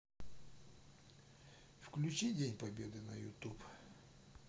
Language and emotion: Russian, neutral